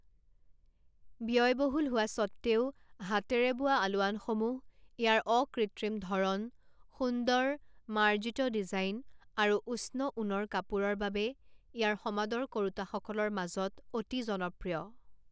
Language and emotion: Assamese, neutral